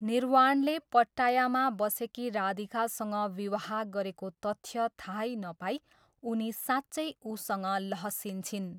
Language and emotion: Nepali, neutral